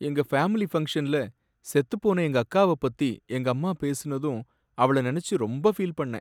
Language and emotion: Tamil, sad